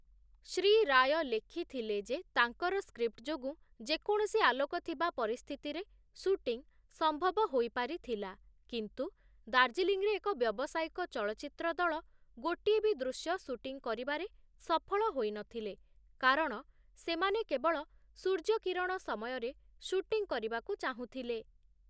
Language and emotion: Odia, neutral